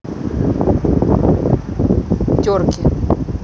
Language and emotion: Russian, neutral